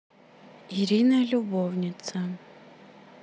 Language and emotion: Russian, neutral